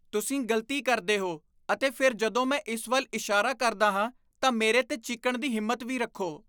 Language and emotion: Punjabi, disgusted